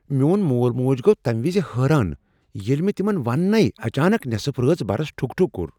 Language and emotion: Kashmiri, surprised